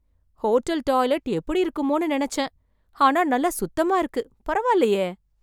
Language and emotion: Tamil, surprised